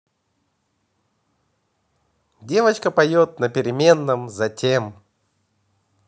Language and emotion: Russian, positive